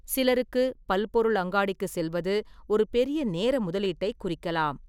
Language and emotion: Tamil, neutral